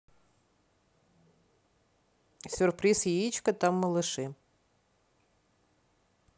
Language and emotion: Russian, neutral